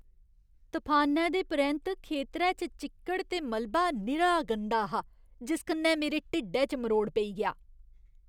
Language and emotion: Dogri, disgusted